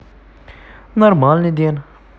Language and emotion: Russian, neutral